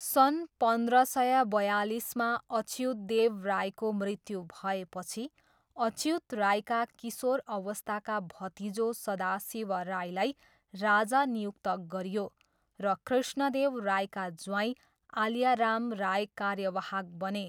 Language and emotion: Nepali, neutral